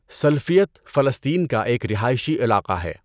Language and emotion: Urdu, neutral